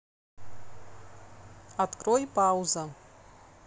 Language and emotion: Russian, neutral